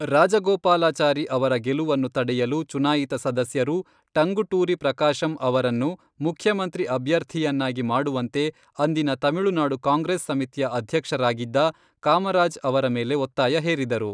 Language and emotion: Kannada, neutral